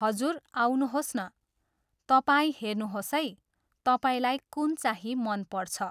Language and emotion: Nepali, neutral